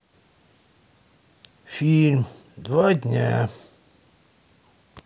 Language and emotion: Russian, sad